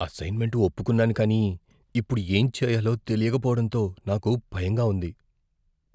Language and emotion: Telugu, fearful